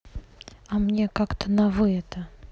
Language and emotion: Russian, neutral